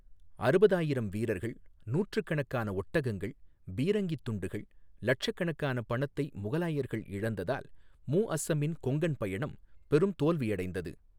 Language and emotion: Tamil, neutral